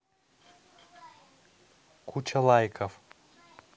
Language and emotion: Russian, neutral